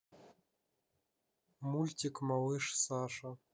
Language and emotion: Russian, neutral